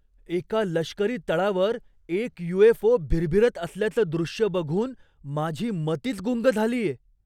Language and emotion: Marathi, surprised